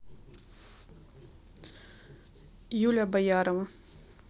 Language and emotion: Russian, neutral